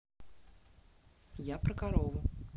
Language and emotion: Russian, neutral